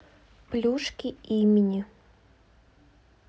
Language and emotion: Russian, neutral